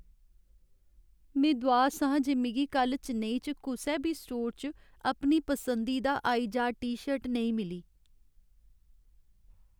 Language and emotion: Dogri, sad